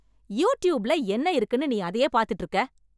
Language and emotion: Tamil, angry